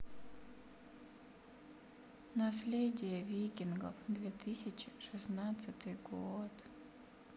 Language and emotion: Russian, sad